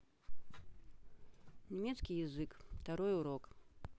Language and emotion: Russian, neutral